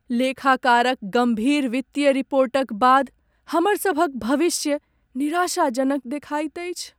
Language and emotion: Maithili, sad